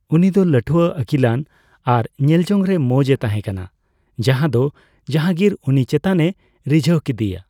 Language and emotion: Santali, neutral